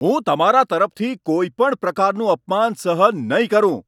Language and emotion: Gujarati, angry